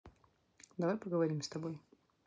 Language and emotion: Russian, neutral